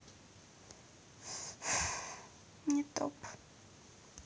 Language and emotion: Russian, sad